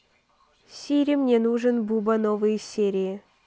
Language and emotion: Russian, neutral